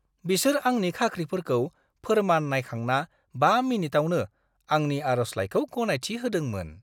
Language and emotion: Bodo, surprised